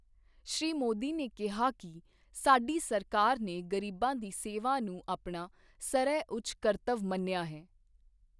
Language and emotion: Punjabi, neutral